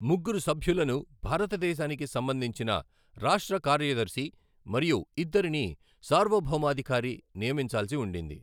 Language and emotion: Telugu, neutral